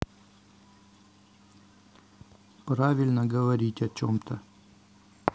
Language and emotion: Russian, neutral